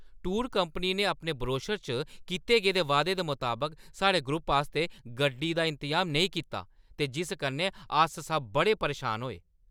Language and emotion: Dogri, angry